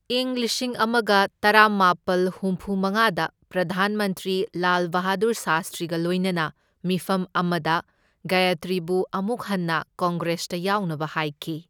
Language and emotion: Manipuri, neutral